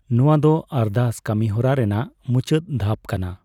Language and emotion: Santali, neutral